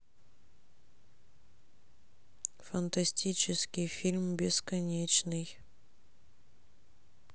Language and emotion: Russian, sad